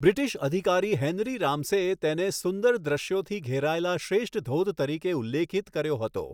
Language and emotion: Gujarati, neutral